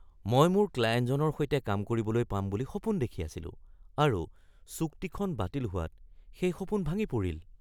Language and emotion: Assamese, surprised